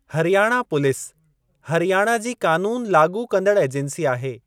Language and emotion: Sindhi, neutral